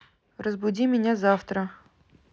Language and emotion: Russian, neutral